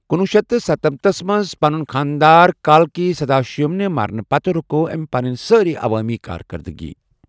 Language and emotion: Kashmiri, neutral